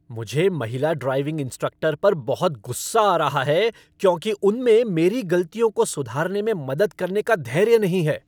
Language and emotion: Hindi, angry